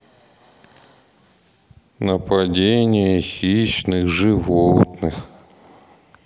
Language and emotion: Russian, sad